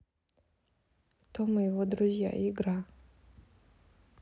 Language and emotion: Russian, neutral